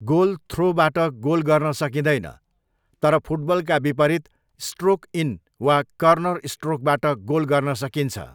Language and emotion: Nepali, neutral